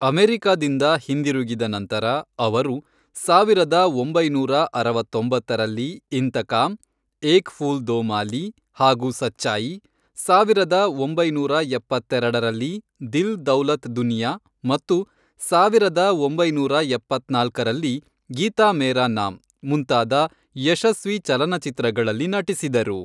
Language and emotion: Kannada, neutral